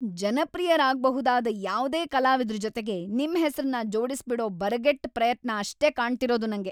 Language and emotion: Kannada, angry